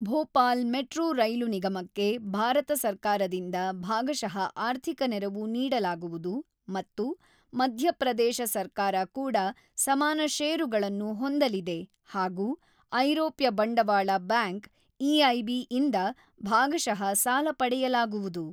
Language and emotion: Kannada, neutral